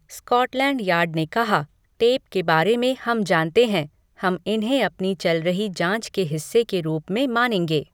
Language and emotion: Hindi, neutral